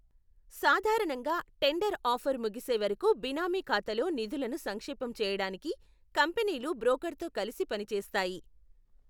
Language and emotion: Telugu, neutral